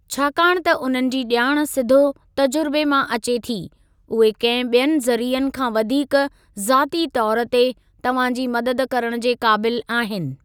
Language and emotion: Sindhi, neutral